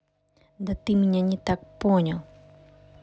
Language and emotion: Russian, neutral